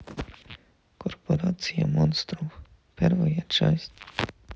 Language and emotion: Russian, neutral